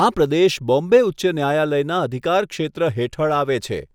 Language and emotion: Gujarati, neutral